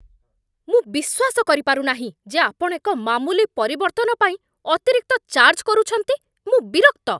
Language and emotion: Odia, angry